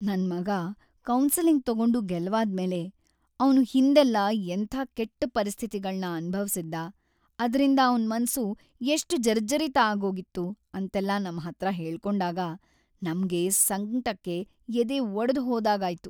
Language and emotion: Kannada, sad